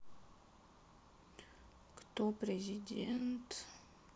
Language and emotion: Russian, sad